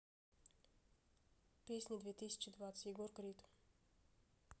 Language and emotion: Russian, neutral